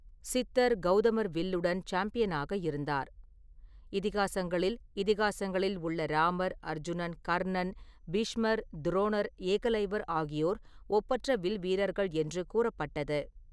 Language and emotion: Tamil, neutral